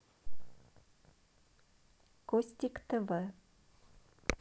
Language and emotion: Russian, neutral